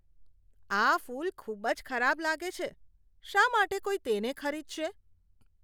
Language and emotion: Gujarati, disgusted